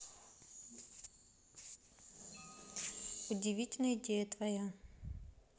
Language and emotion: Russian, neutral